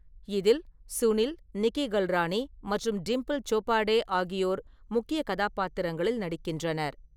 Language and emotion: Tamil, neutral